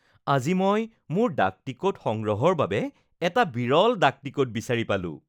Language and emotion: Assamese, happy